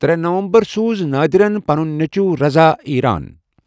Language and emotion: Kashmiri, neutral